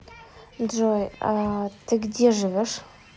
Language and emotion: Russian, neutral